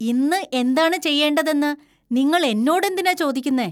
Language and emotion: Malayalam, disgusted